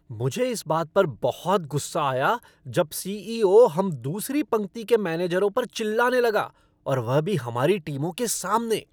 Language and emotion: Hindi, angry